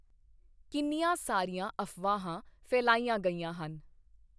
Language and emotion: Punjabi, neutral